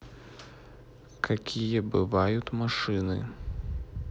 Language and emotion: Russian, neutral